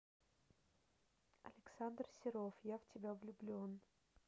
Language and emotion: Russian, neutral